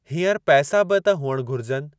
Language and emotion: Sindhi, neutral